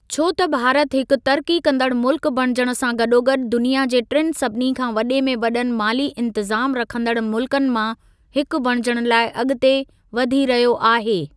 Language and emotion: Sindhi, neutral